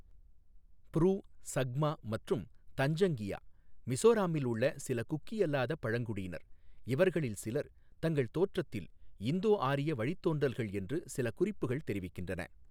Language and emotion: Tamil, neutral